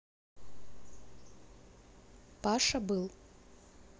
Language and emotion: Russian, neutral